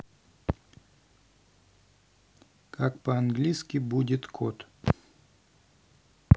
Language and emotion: Russian, neutral